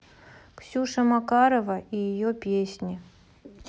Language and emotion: Russian, neutral